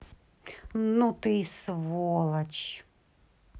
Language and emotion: Russian, angry